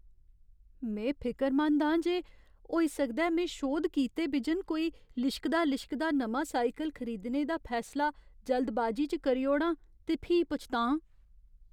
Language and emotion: Dogri, fearful